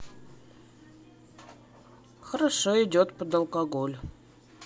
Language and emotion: Russian, neutral